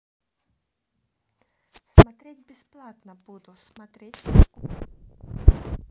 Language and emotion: Russian, neutral